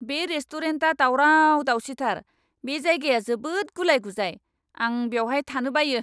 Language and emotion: Bodo, angry